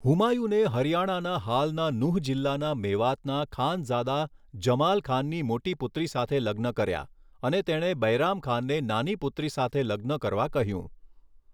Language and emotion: Gujarati, neutral